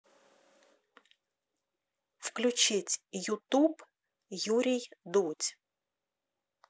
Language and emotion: Russian, neutral